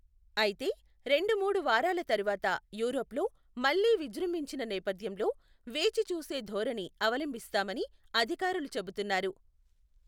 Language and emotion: Telugu, neutral